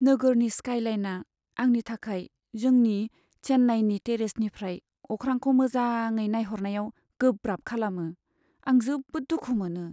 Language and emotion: Bodo, sad